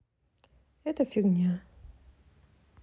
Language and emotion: Russian, neutral